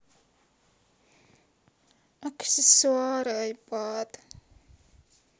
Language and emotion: Russian, sad